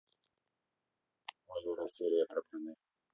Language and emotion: Russian, neutral